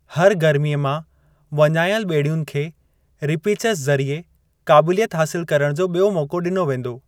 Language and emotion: Sindhi, neutral